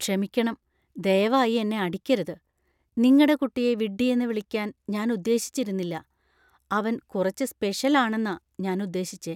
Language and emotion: Malayalam, fearful